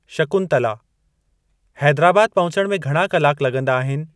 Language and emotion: Sindhi, neutral